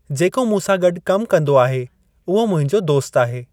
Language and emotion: Sindhi, neutral